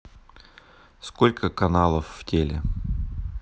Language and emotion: Russian, neutral